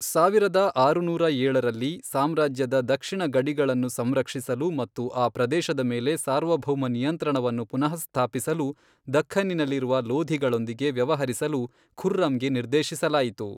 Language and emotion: Kannada, neutral